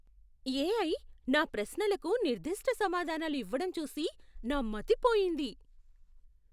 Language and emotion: Telugu, surprised